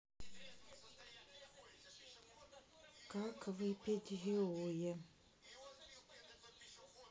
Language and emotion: Russian, neutral